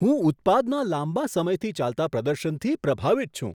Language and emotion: Gujarati, surprised